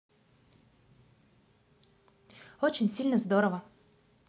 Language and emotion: Russian, positive